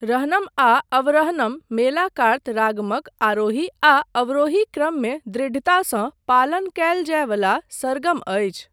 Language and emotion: Maithili, neutral